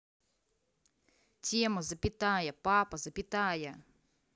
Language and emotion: Russian, angry